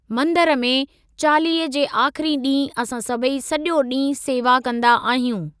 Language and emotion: Sindhi, neutral